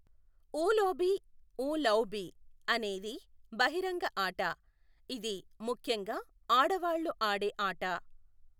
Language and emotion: Telugu, neutral